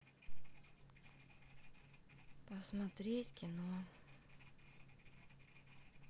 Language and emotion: Russian, sad